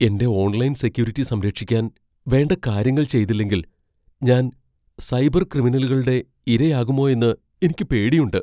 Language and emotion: Malayalam, fearful